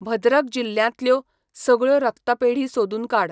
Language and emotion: Goan Konkani, neutral